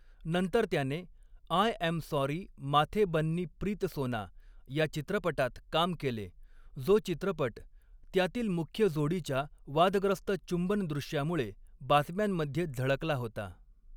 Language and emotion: Marathi, neutral